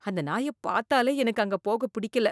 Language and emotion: Tamil, disgusted